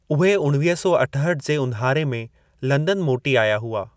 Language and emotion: Sindhi, neutral